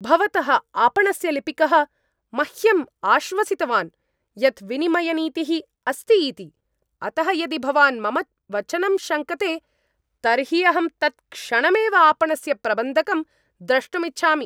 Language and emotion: Sanskrit, angry